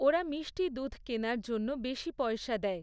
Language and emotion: Bengali, neutral